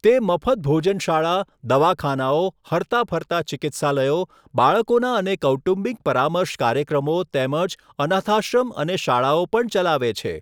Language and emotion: Gujarati, neutral